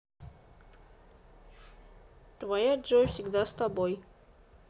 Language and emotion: Russian, neutral